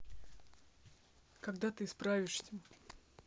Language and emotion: Russian, neutral